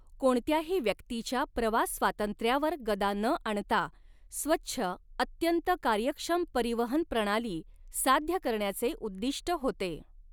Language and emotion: Marathi, neutral